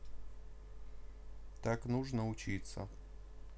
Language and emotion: Russian, neutral